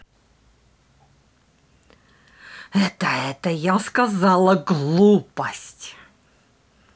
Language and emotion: Russian, angry